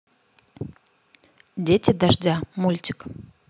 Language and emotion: Russian, neutral